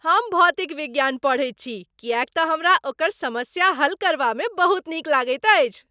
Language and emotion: Maithili, happy